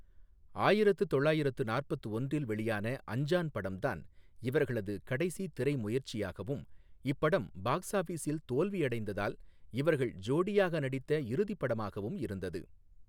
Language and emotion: Tamil, neutral